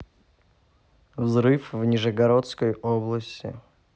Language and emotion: Russian, neutral